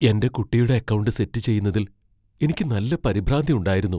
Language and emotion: Malayalam, fearful